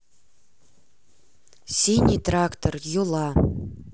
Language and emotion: Russian, neutral